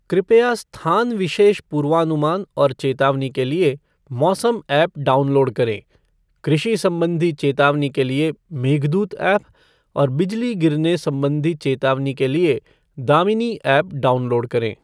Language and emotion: Hindi, neutral